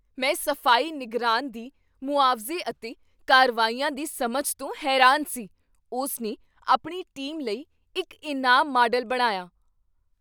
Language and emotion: Punjabi, surprised